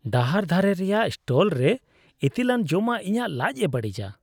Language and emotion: Santali, disgusted